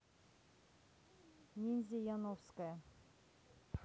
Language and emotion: Russian, neutral